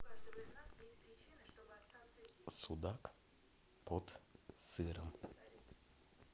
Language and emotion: Russian, neutral